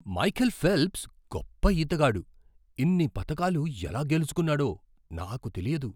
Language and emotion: Telugu, surprised